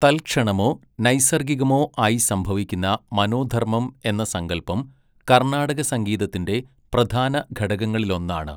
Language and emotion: Malayalam, neutral